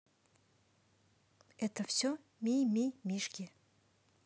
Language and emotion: Russian, positive